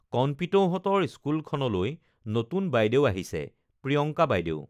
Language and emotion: Assamese, neutral